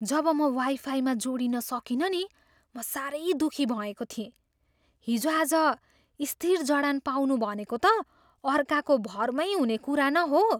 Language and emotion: Nepali, surprised